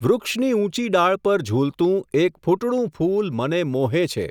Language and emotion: Gujarati, neutral